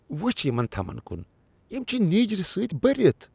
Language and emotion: Kashmiri, disgusted